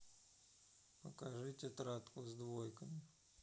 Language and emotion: Russian, neutral